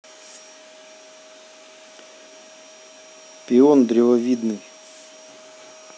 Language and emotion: Russian, neutral